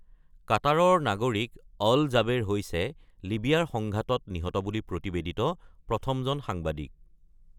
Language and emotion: Assamese, neutral